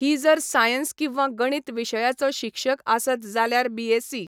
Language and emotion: Goan Konkani, neutral